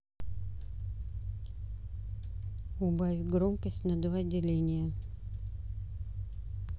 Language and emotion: Russian, neutral